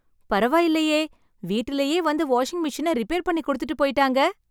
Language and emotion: Tamil, happy